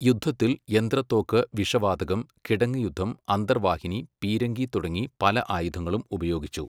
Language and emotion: Malayalam, neutral